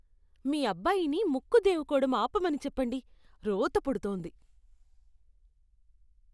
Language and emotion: Telugu, disgusted